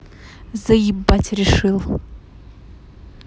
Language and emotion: Russian, angry